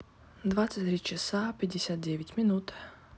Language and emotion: Russian, neutral